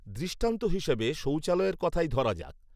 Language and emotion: Bengali, neutral